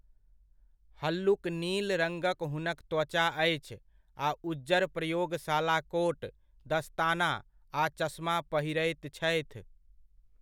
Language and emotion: Maithili, neutral